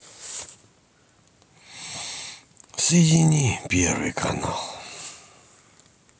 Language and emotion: Russian, sad